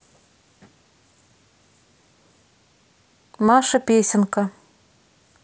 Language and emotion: Russian, neutral